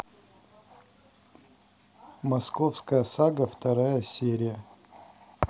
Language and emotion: Russian, neutral